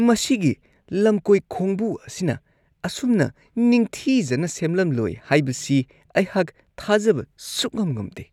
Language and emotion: Manipuri, disgusted